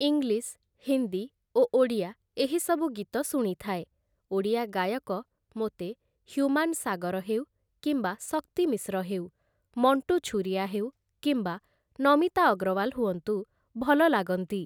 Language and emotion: Odia, neutral